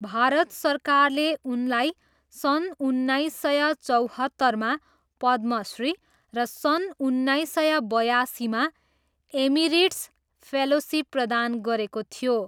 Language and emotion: Nepali, neutral